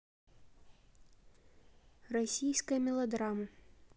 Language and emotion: Russian, neutral